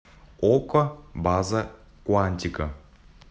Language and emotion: Russian, neutral